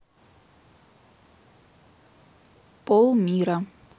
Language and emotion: Russian, neutral